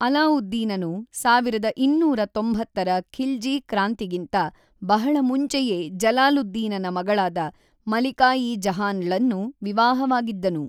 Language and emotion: Kannada, neutral